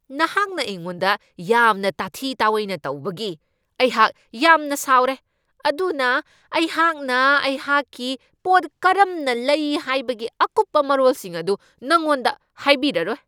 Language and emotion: Manipuri, angry